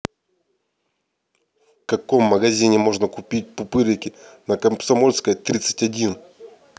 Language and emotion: Russian, neutral